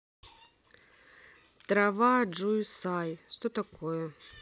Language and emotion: Russian, neutral